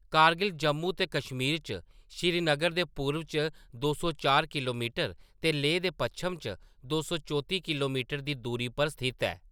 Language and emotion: Dogri, neutral